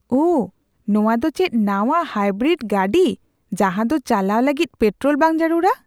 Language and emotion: Santali, surprised